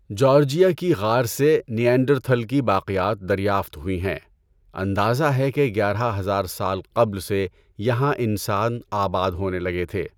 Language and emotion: Urdu, neutral